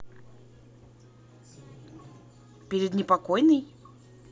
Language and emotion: Russian, neutral